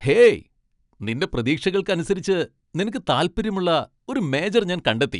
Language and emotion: Malayalam, happy